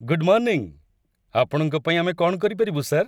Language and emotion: Odia, happy